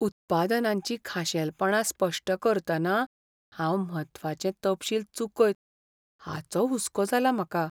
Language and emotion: Goan Konkani, fearful